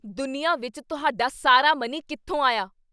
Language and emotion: Punjabi, angry